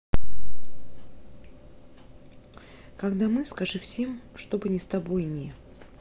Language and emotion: Russian, neutral